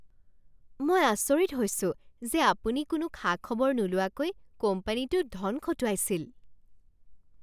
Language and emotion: Assamese, surprised